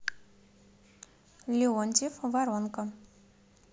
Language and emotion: Russian, neutral